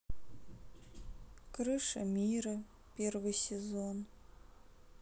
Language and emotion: Russian, sad